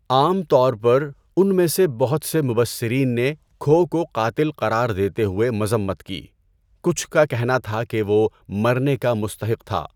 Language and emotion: Urdu, neutral